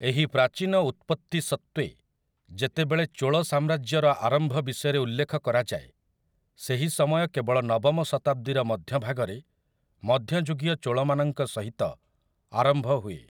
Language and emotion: Odia, neutral